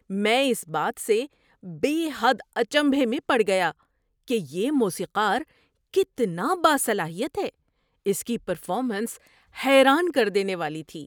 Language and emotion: Urdu, surprised